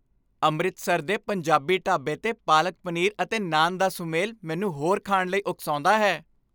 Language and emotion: Punjabi, happy